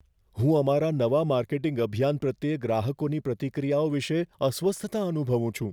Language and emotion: Gujarati, fearful